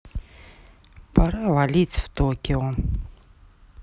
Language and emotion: Russian, neutral